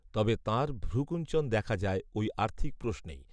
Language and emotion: Bengali, neutral